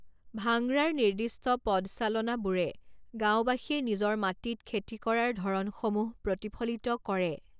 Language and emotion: Assamese, neutral